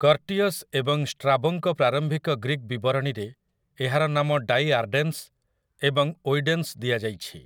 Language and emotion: Odia, neutral